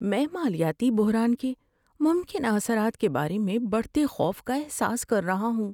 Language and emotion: Urdu, fearful